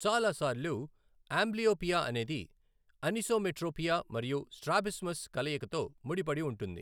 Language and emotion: Telugu, neutral